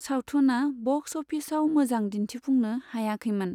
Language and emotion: Bodo, neutral